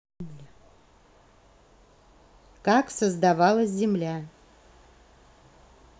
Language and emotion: Russian, neutral